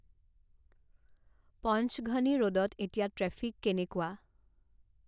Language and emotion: Assamese, neutral